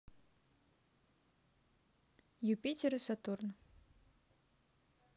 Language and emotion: Russian, neutral